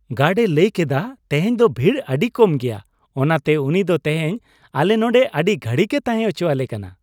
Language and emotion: Santali, happy